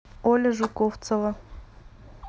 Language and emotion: Russian, neutral